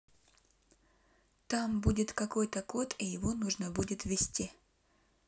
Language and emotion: Russian, neutral